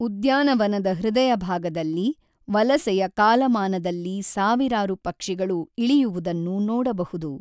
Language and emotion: Kannada, neutral